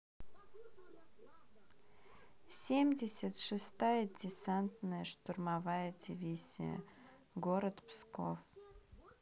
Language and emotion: Russian, neutral